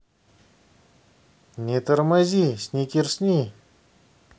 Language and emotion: Russian, positive